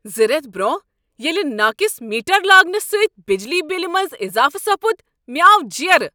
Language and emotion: Kashmiri, angry